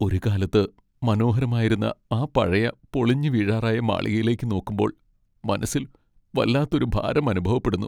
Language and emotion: Malayalam, sad